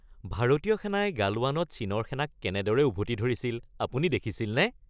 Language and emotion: Assamese, happy